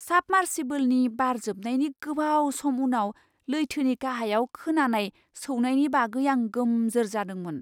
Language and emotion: Bodo, surprised